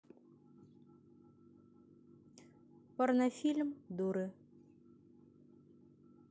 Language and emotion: Russian, neutral